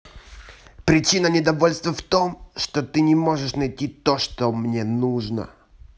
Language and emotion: Russian, angry